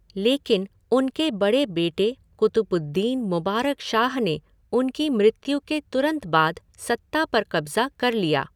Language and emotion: Hindi, neutral